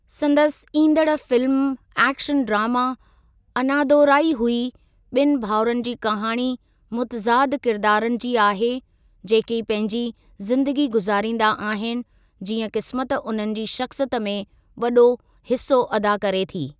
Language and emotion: Sindhi, neutral